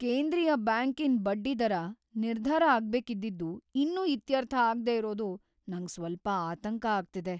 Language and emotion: Kannada, fearful